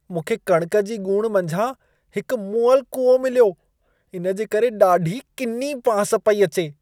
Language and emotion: Sindhi, disgusted